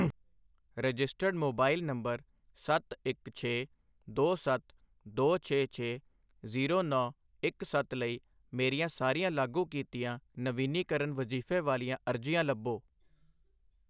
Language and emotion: Punjabi, neutral